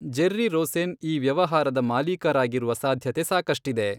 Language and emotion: Kannada, neutral